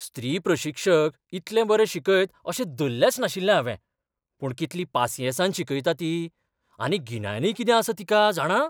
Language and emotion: Goan Konkani, surprised